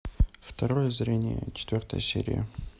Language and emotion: Russian, neutral